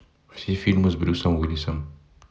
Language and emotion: Russian, neutral